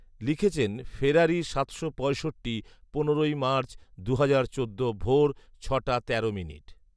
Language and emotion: Bengali, neutral